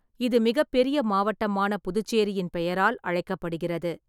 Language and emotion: Tamil, neutral